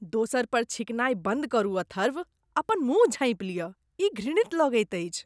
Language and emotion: Maithili, disgusted